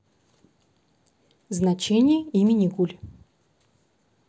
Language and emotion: Russian, neutral